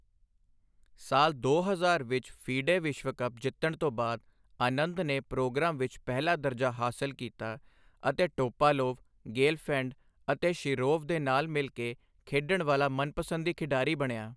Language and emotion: Punjabi, neutral